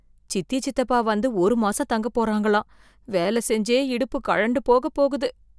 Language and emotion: Tamil, fearful